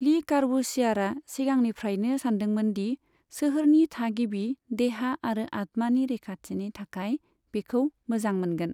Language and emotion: Bodo, neutral